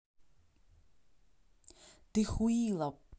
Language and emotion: Russian, angry